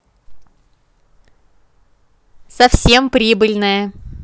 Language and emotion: Russian, positive